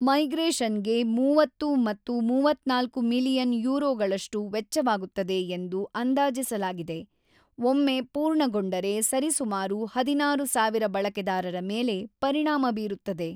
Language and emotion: Kannada, neutral